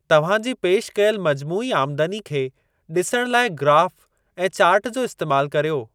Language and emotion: Sindhi, neutral